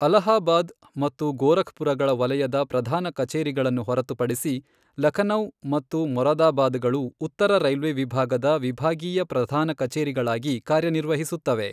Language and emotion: Kannada, neutral